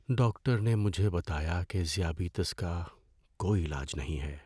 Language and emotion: Urdu, sad